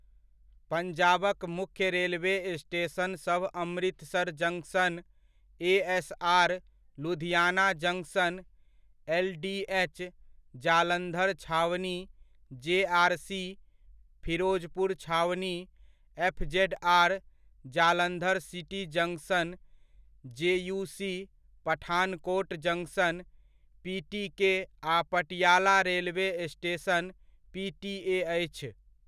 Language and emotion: Maithili, neutral